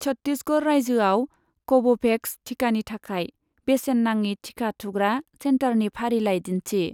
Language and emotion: Bodo, neutral